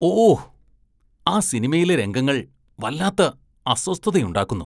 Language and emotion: Malayalam, disgusted